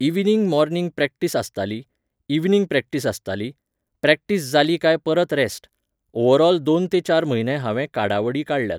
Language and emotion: Goan Konkani, neutral